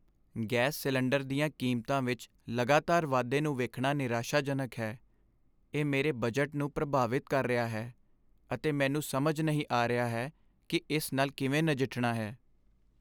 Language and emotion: Punjabi, sad